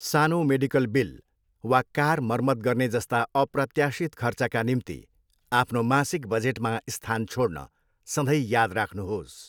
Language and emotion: Nepali, neutral